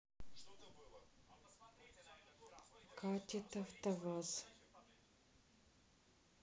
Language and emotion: Russian, neutral